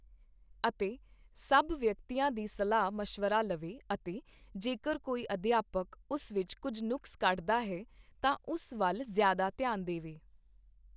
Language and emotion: Punjabi, neutral